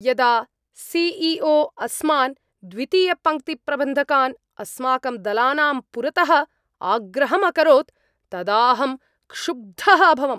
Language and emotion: Sanskrit, angry